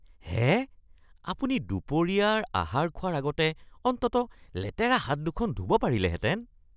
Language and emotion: Assamese, disgusted